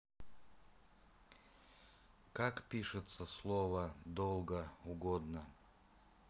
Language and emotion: Russian, neutral